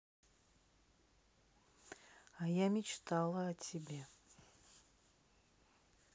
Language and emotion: Russian, neutral